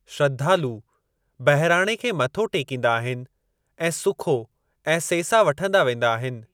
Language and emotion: Sindhi, neutral